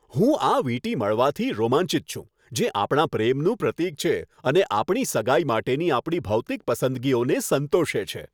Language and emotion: Gujarati, happy